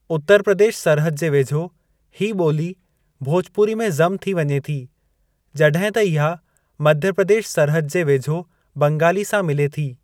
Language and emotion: Sindhi, neutral